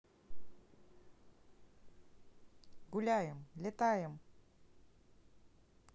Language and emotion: Russian, neutral